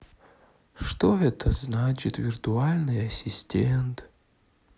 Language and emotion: Russian, sad